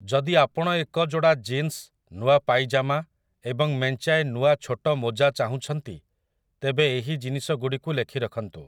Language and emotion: Odia, neutral